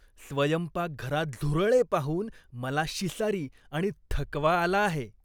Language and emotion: Marathi, disgusted